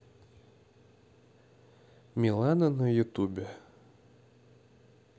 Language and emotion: Russian, neutral